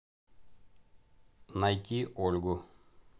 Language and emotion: Russian, neutral